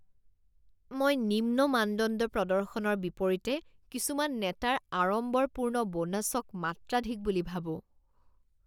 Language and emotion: Assamese, disgusted